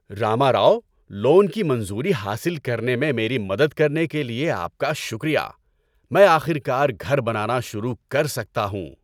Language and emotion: Urdu, happy